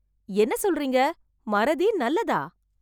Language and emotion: Tamil, surprised